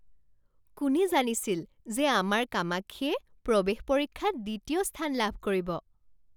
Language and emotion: Assamese, surprised